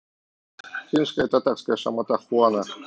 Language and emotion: Russian, neutral